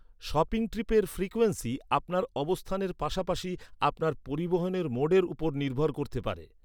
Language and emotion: Bengali, neutral